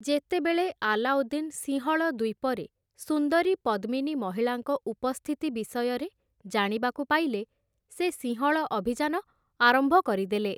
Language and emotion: Odia, neutral